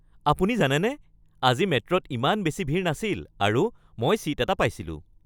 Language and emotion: Assamese, happy